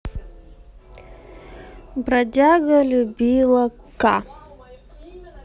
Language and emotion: Russian, neutral